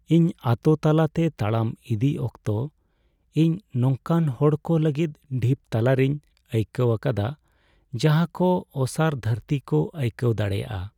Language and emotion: Santali, sad